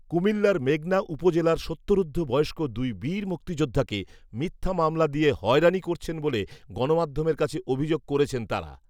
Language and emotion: Bengali, neutral